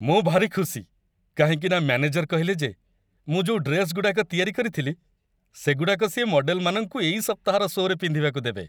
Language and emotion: Odia, happy